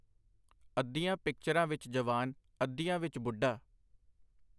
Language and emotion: Punjabi, neutral